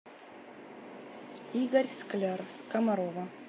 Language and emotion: Russian, neutral